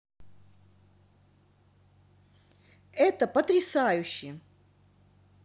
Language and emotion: Russian, positive